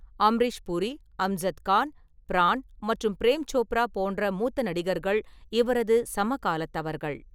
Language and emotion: Tamil, neutral